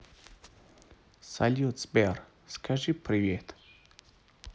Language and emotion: Russian, neutral